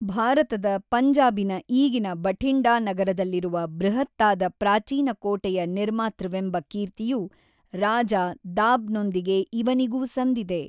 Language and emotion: Kannada, neutral